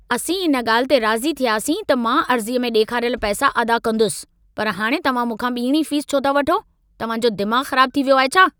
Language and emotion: Sindhi, angry